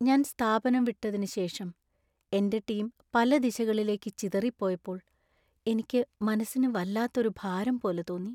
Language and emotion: Malayalam, sad